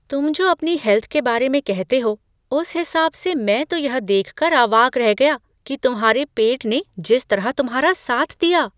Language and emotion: Hindi, surprised